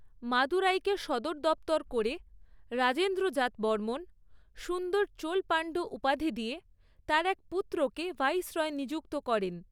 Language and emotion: Bengali, neutral